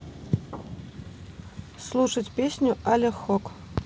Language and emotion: Russian, neutral